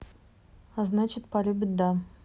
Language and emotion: Russian, neutral